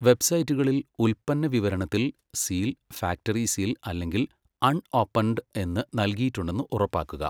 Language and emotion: Malayalam, neutral